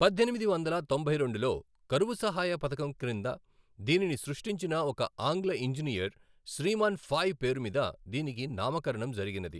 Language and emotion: Telugu, neutral